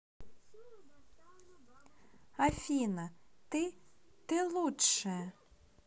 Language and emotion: Russian, positive